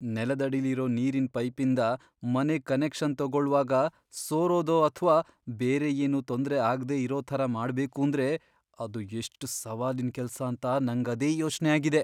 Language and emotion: Kannada, fearful